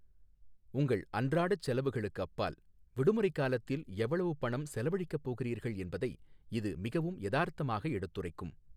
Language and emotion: Tamil, neutral